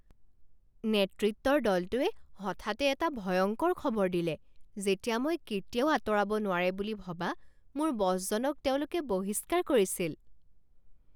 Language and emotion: Assamese, surprised